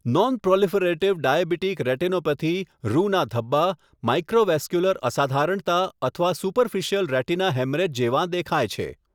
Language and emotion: Gujarati, neutral